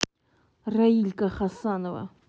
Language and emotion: Russian, angry